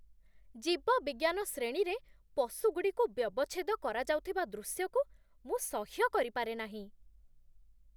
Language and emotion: Odia, disgusted